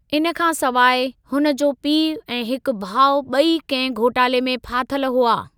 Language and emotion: Sindhi, neutral